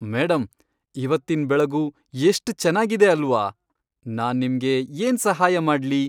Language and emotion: Kannada, happy